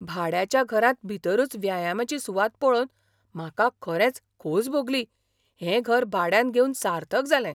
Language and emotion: Goan Konkani, surprised